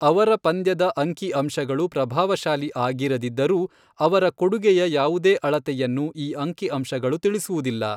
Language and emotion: Kannada, neutral